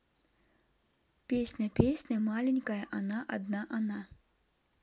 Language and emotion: Russian, neutral